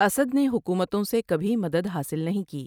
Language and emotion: Urdu, neutral